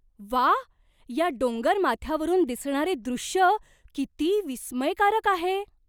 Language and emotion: Marathi, surprised